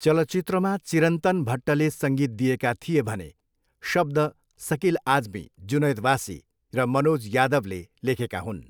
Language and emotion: Nepali, neutral